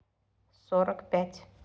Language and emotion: Russian, neutral